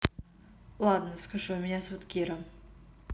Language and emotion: Russian, neutral